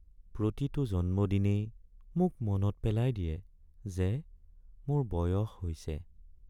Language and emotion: Assamese, sad